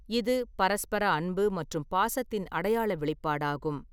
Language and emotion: Tamil, neutral